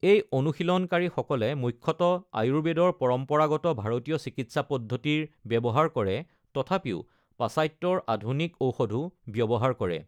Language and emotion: Assamese, neutral